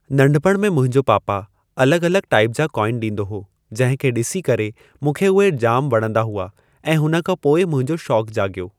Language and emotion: Sindhi, neutral